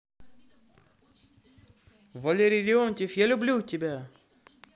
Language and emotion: Russian, positive